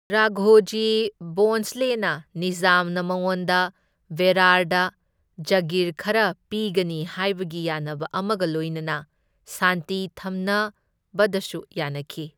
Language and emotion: Manipuri, neutral